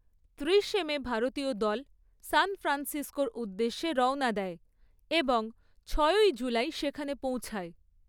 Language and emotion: Bengali, neutral